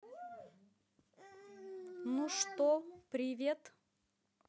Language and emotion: Russian, positive